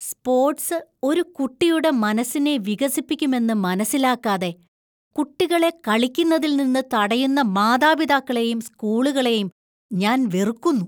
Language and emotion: Malayalam, disgusted